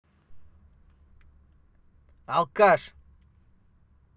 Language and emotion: Russian, angry